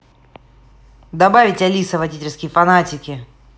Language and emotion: Russian, angry